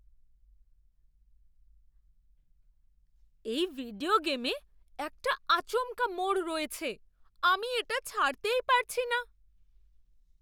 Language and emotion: Bengali, surprised